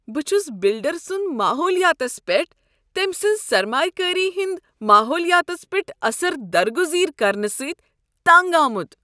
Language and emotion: Kashmiri, disgusted